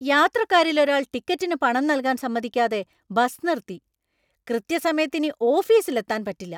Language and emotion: Malayalam, angry